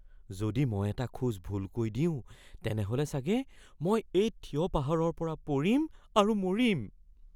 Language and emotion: Assamese, fearful